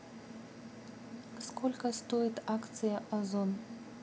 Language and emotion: Russian, neutral